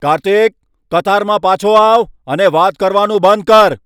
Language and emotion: Gujarati, angry